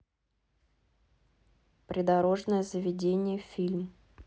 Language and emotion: Russian, neutral